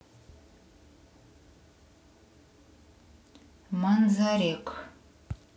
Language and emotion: Russian, neutral